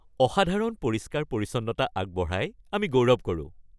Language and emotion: Assamese, happy